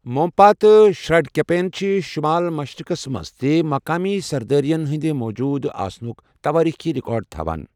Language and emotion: Kashmiri, neutral